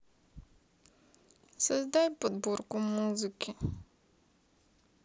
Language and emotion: Russian, sad